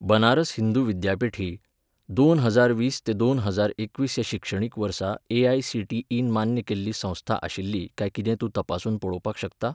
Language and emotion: Goan Konkani, neutral